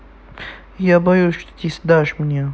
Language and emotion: Russian, neutral